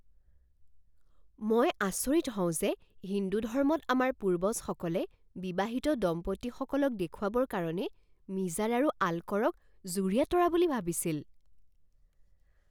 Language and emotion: Assamese, surprised